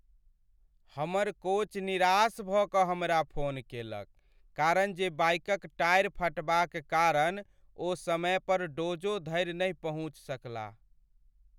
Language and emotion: Maithili, sad